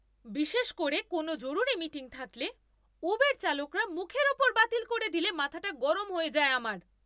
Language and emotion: Bengali, angry